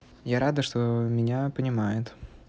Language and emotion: Russian, neutral